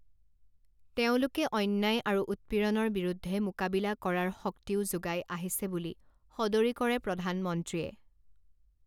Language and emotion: Assamese, neutral